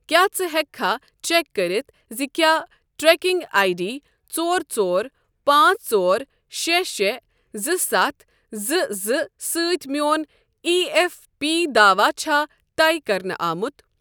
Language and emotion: Kashmiri, neutral